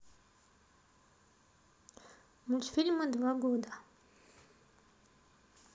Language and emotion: Russian, neutral